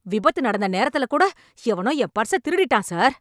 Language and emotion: Tamil, angry